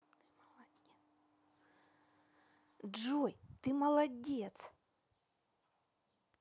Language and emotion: Russian, positive